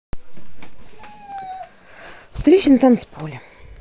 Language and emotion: Russian, neutral